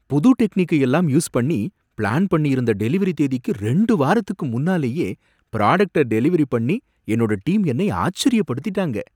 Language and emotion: Tamil, surprised